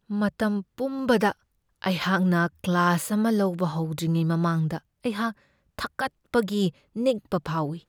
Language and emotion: Manipuri, fearful